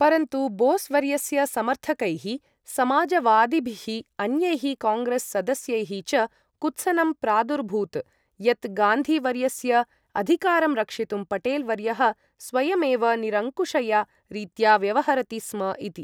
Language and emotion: Sanskrit, neutral